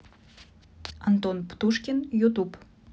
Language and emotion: Russian, neutral